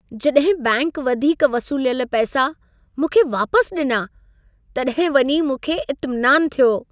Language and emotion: Sindhi, happy